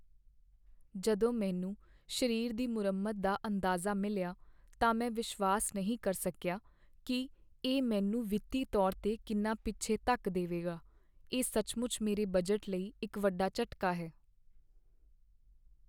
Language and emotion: Punjabi, sad